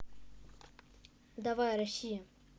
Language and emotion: Russian, neutral